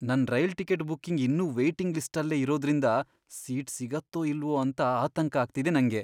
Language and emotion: Kannada, fearful